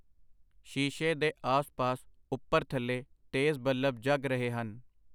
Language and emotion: Punjabi, neutral